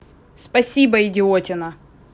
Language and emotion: Russian, angry